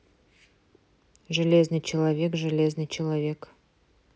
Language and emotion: Russian, neutral